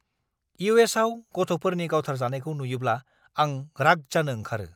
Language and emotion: Bodo, angry